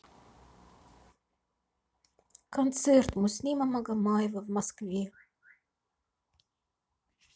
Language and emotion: Russian, sad